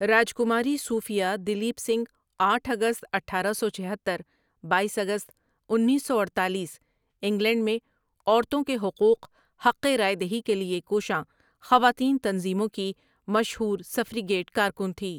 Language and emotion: Urdu, neutral